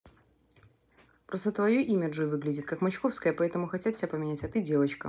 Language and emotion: Russian, neutral